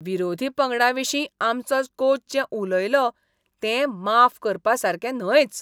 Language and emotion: Goan Konkani, disgusted